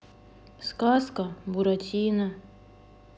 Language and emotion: Russian, sad